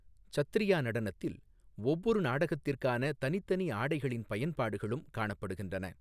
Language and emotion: Tamil, neutral